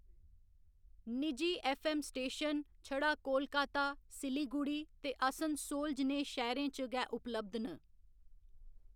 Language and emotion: Dogri, neutral